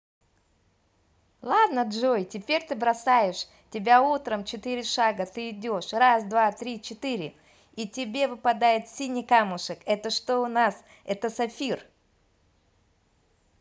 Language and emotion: Russian, positive